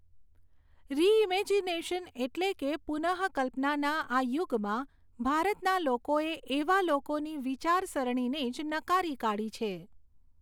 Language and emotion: Gujarati, neutral